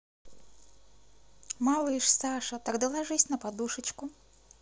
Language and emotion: Russian, neutral